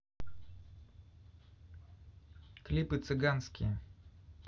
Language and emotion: Russian, neutral